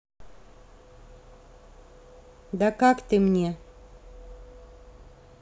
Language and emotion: Russian, neutral